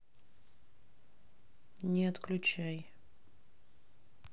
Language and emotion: Russian, neutral